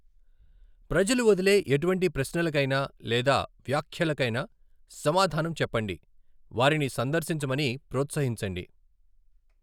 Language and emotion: Telugu, neutral